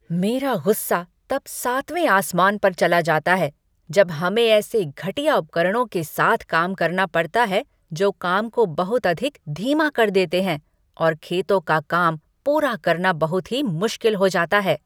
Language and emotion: Hindi, angry